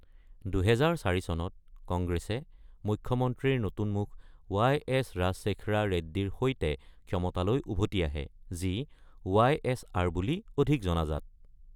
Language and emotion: Assamese, neutral